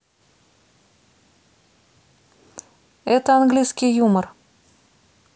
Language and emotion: Russian, neutral